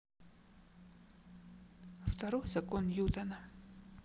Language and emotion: Russian, sad